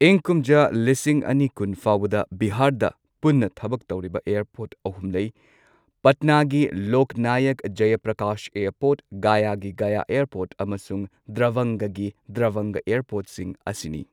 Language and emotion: Manipuri, neutral